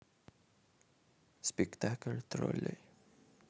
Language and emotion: Russian, neutral